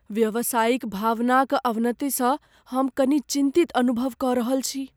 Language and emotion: Maithili, fearful